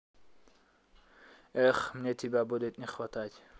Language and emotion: Russian, sad